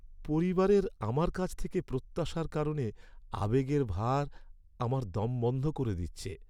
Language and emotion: Bengali, sad